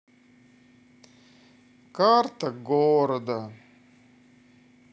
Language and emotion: Russian, sad